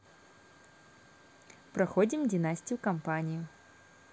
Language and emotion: Russian, positive